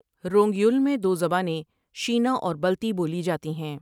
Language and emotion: Urdu, neutral